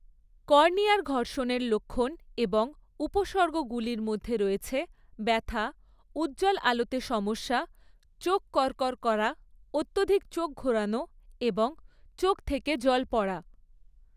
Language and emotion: Bengali, neutral